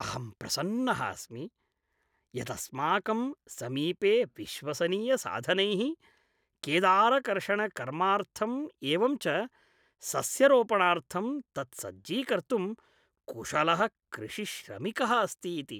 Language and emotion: Sanskrit, happy